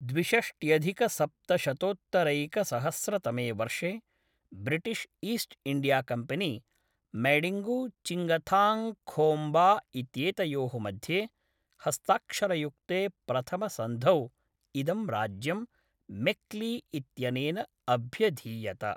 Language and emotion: Sanskrit, neutral